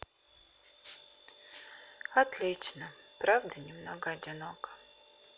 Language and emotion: Russian, sad